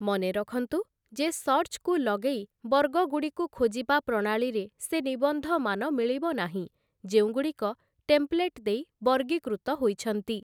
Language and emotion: Odia, neutral